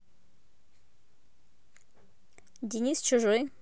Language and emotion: Russian, neutral